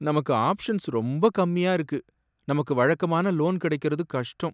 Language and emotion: Tamil, sad